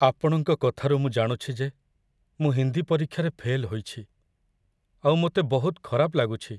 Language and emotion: Odia, sad